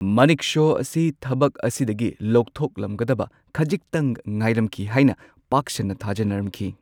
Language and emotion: Manipuri, neutral